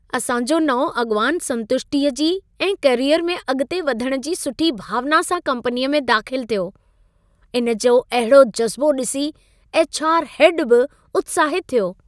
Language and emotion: Sindhi, happy